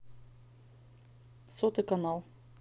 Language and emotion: Russian, neutral